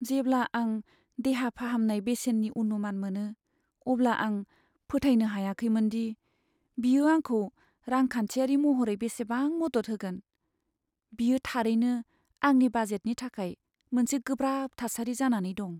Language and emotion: Bodo, sad